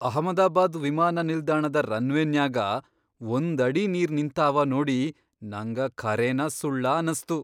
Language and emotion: Kannada, surprised